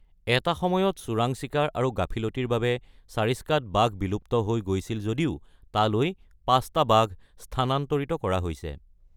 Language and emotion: Assamese, neutral